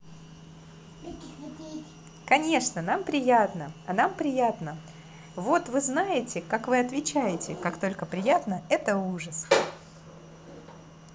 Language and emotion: Russian, positive